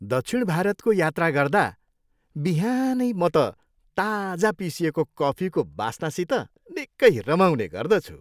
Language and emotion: Nepali, happy